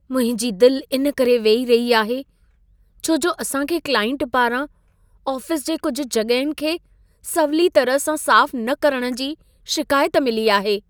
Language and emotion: Sindhi, sad